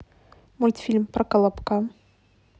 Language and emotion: Russian, neutral